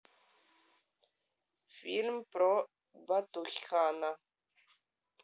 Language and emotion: Russian, neutral